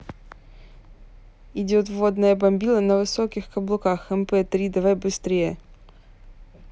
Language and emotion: Russian, neutral